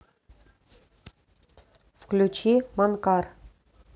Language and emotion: Russian, neutral